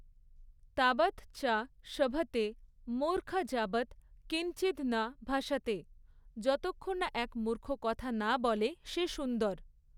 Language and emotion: Bengali, neutral